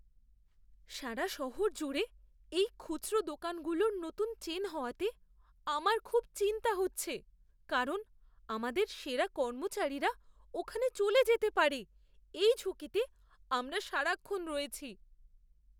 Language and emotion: Bengali, fearful